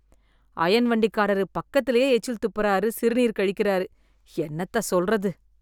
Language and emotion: Tamil, disgusted